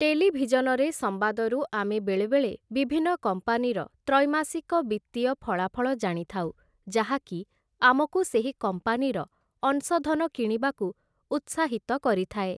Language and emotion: Odia, neutral